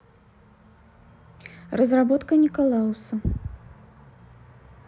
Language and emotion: Russian, neutral